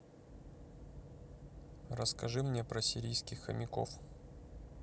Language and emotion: Russian, neutral